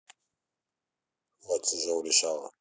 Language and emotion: Russian, neutral